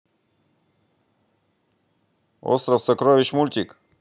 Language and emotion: Russian, positive